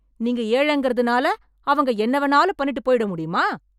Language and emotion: Tamil, angry